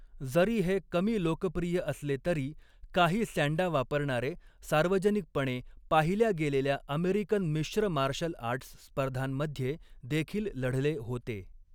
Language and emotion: Marathi, neutral